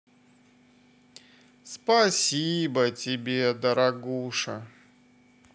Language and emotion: Russian, positive